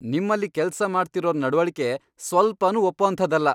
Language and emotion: Kannada, angry